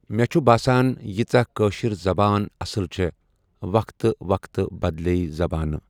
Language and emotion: Kashmiri, neutral